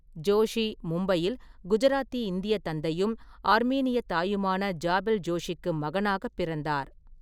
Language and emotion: Tamil, neutral